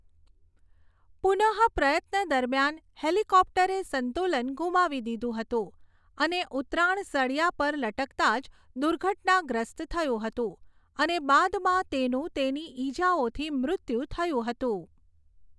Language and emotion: Gujarati, neutral